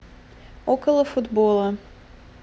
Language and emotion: Russian, neutral